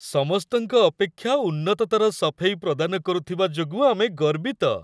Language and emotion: Odia, happy